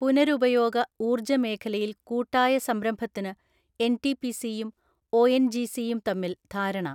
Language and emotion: Malayalam, neutral